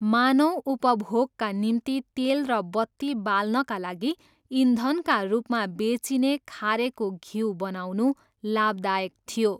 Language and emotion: Nepali, neutral